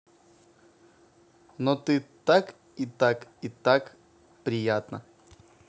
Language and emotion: Russian, positive